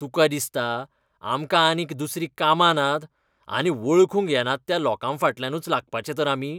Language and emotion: Goan Konkani, disgusted